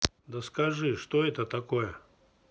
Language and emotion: Russian, neutral